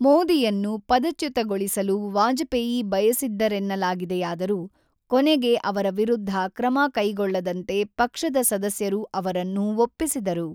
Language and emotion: Kannada, neutral